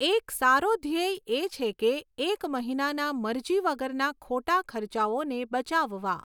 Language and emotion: Gujarati, neutral